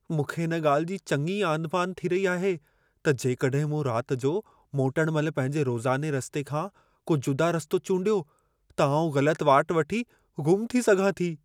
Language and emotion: Sindhi, fearful